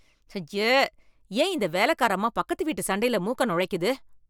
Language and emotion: Tamil, disgusted